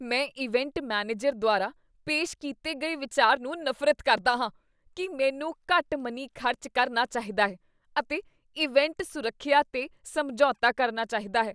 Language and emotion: Punjabi, disgusted